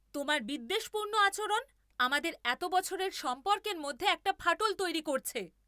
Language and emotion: Bengali, angry